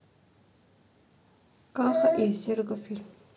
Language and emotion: Russian, neutral